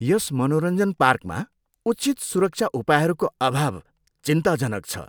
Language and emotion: Nepali, disgusted